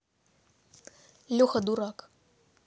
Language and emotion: Russian, neutral